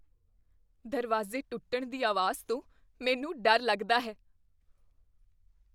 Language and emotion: Punjabi, fearful